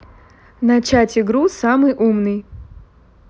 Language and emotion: Russian, neutral